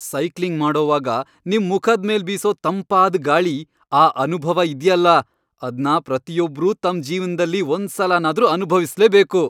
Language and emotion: Kannada, happy